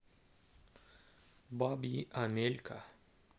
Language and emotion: Russian, neutral